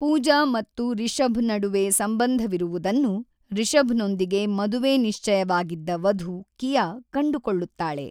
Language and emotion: Kannada, neutral